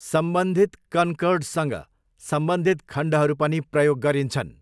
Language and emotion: Nepali, neutral